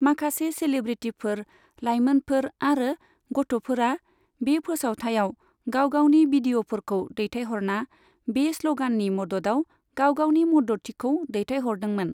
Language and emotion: Bodo, neutral